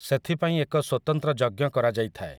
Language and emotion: Odia, neutral